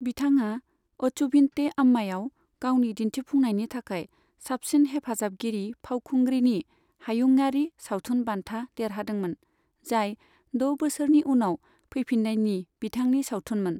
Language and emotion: Bodo, neutral